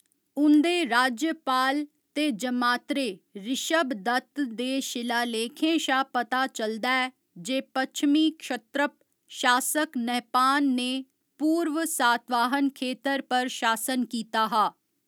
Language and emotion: Dogri, neutral